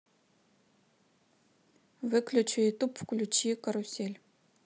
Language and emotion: Russian, neutral